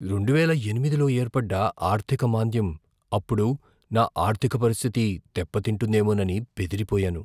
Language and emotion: Telugu, fearful